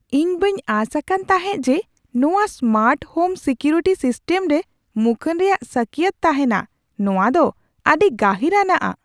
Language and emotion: Santali, surprised